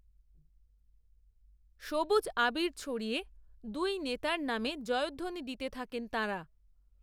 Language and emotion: Bengali, neutral